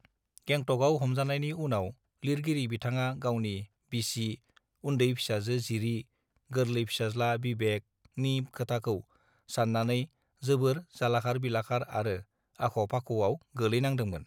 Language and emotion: Bodo, neutral